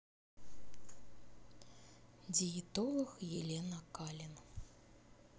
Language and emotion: Russian, neutral